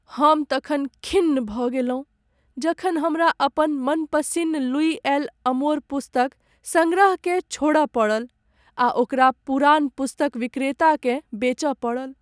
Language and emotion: Maithili, sad